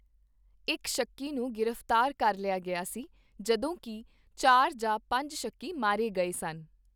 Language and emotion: Punjabi, neutral